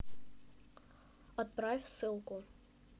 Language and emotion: Russian, neutral